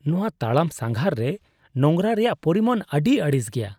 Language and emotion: Santali, disgusted